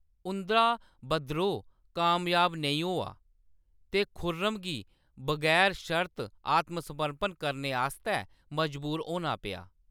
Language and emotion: Dogri, neutral